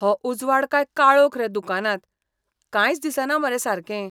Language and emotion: Goan Konkani, disgusted